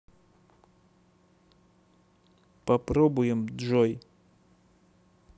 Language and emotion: Russian, neutral